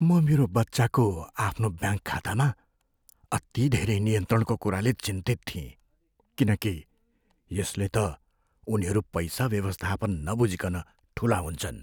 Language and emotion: Nepali, fearful